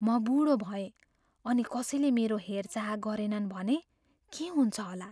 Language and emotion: Nepali, fearful